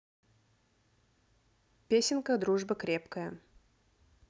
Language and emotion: Russian, neutral